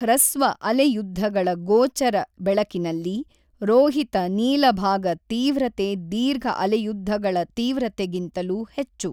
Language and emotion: Kannada, neutral